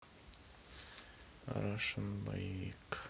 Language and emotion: Russian, sad